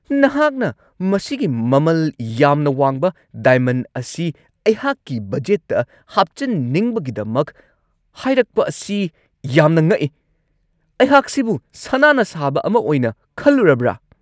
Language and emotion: Manipuri, angry